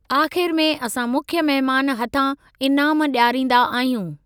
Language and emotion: Sindhi, neutral